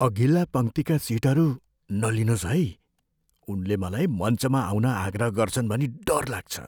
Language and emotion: Nepali, fearful